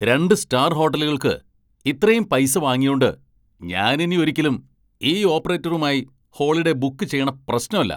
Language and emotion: Malayalam, angry